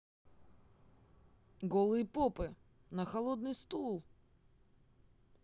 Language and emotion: Russian, positive